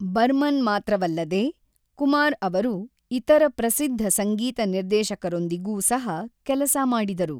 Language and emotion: Kannada, neutral